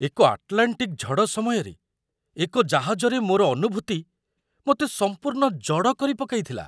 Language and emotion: Odia, surprised